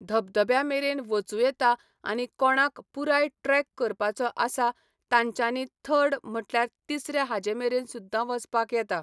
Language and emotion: Goan Konkani, neutral